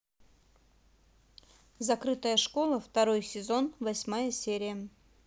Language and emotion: Russian, neutral